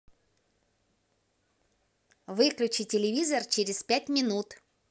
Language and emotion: Russian, positive